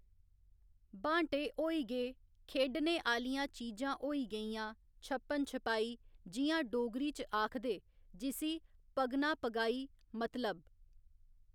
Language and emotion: Dogri, neutral